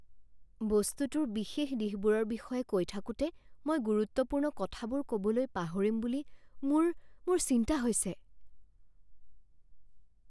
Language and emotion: Assamese, fearful